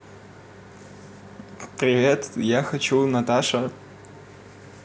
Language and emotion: Russian, neutral